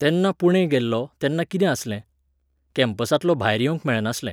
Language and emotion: Goan Konkani, neutral